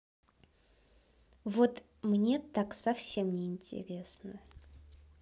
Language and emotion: Russian, neutral